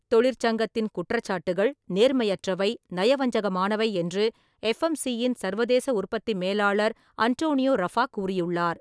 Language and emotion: Tamil, neutral